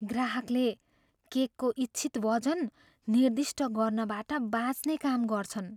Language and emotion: Nepali, fearful